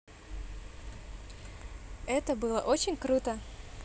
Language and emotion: Russian, neutral